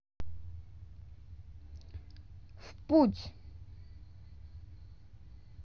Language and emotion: Russian, neutral